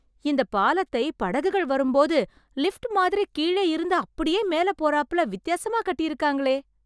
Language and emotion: Tamil, surprised